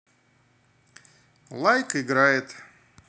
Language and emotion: Russian, positive